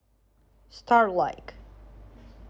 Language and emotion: Russian, neutral